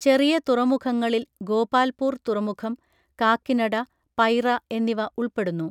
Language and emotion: Malayalam, neutral